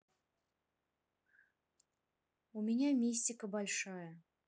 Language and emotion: Russian, neutral